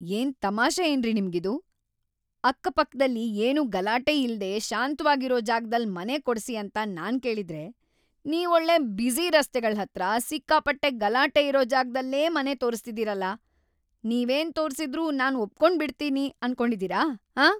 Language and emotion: Kannada, angry